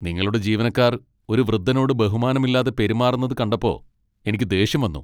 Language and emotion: Malayalam, angry